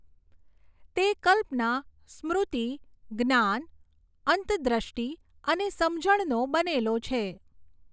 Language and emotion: Gujarati, neutral